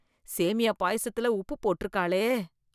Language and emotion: Tamil, disgusted